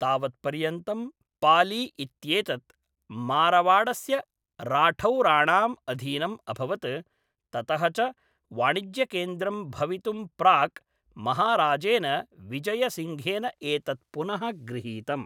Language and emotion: Sanskrit, neutral